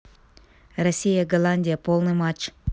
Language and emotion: Russian, neutral